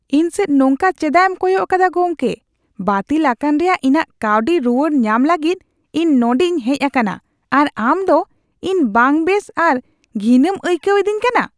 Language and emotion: Santali, disgusted